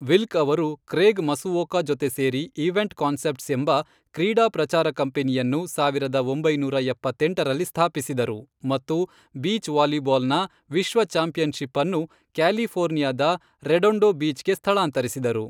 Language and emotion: Kannada, neutral